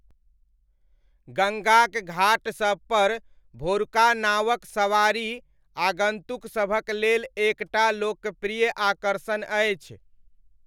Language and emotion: Maithili, neutral